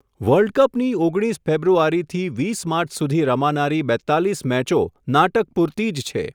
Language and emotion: Gujarati, neutral